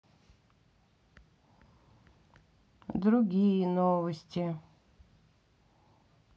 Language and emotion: Russian, sad